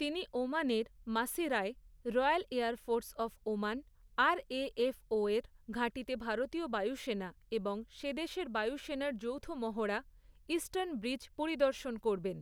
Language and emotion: Bengali, neutral